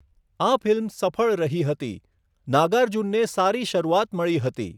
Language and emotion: Gujarati, neutral